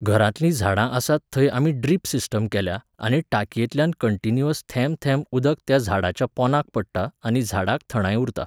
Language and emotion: Goan Konkani, neutral